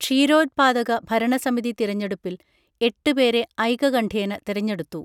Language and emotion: Malayalam, neutral